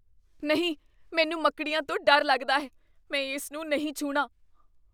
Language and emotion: Punjabi, fearful